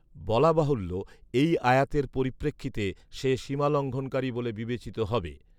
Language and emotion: Bengali, neutral